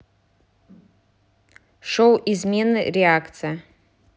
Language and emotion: Russian, neutral